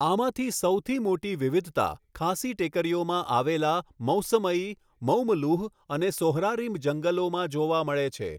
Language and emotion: Gujarati, neutral